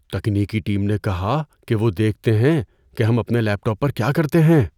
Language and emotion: Urdu, fearful